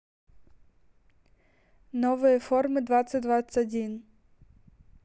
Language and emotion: Russian, neutral